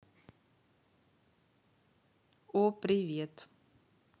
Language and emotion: Russian, neutral